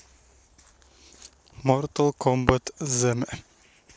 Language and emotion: Russian, neutral